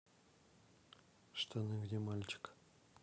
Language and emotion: Russian, neutral